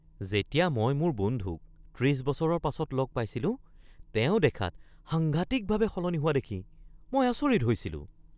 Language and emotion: Assamese, surprised